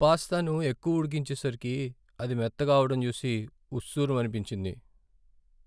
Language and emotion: Telugu, sad